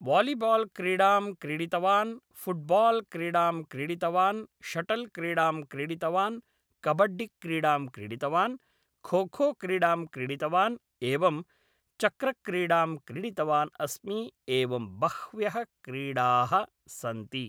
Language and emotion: Sanskrit, neutral